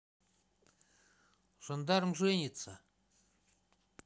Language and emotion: Russian, neutral